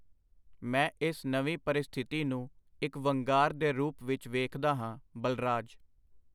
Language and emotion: Punjabi, neutral